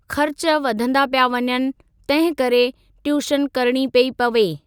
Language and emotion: Sindhi, neutral